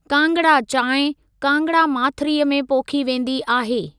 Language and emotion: Sindhi, neutral